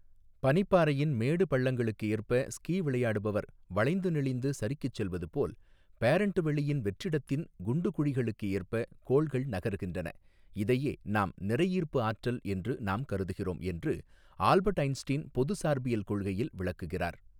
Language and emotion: Tamil, neutral